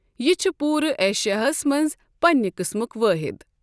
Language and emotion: Kashmiri, neutral